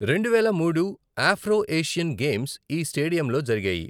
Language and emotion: Telugu, neutral